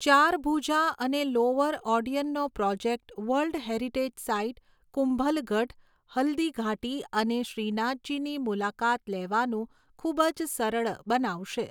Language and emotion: Gujarati, neutral